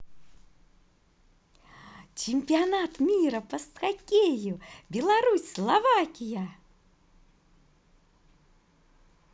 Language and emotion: Russian, positive